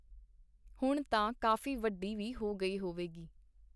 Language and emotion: Punjabi, neutral